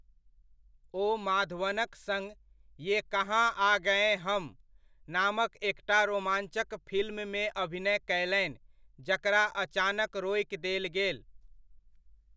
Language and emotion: Maithili, neutral